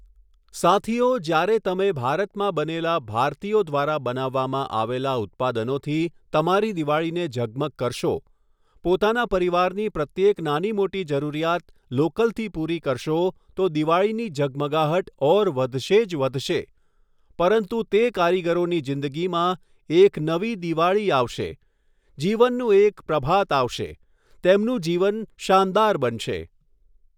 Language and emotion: Gujarati, neutral